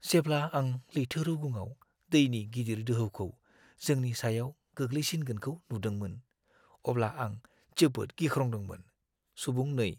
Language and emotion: Bodo, fearful